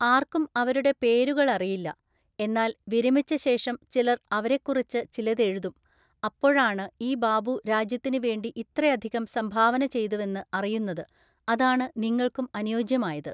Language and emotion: Malayalam, neutral